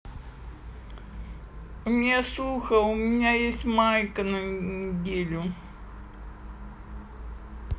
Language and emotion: Russian, sad